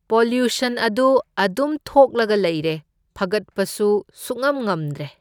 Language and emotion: Manipuri, neutral